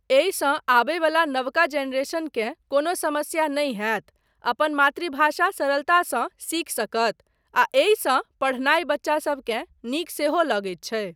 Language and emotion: Maithili, neutral